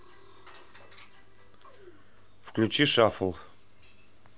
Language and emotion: Russian, neutral